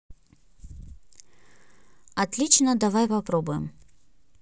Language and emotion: Russian, neutral